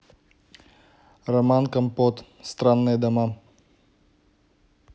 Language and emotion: Russian, neutral